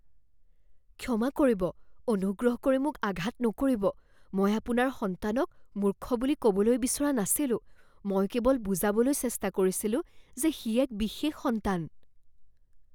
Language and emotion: Assamese, fearful